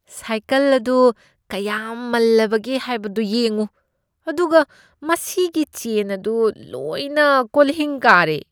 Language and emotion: Manipuri, disgusted